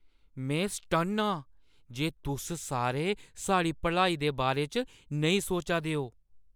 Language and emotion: Dogri, surprised